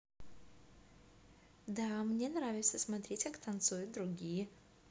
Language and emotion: Russian, positive